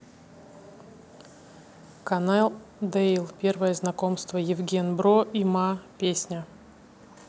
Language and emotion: Russian, neutral